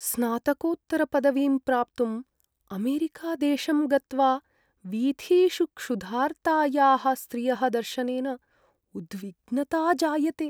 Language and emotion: Sanskrit, sad